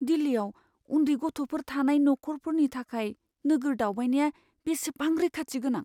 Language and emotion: Bodo, fearful